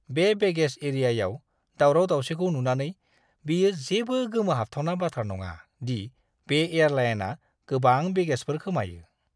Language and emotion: Bodo, disgusted